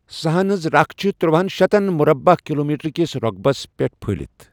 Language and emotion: Kashmiri, neutral